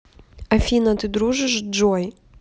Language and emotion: Russian, neutral